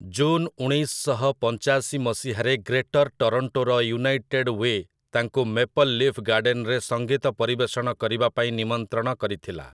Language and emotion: Odia, neutral